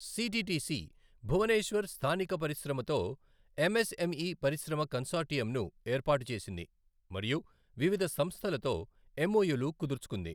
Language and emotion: Telugu, neutral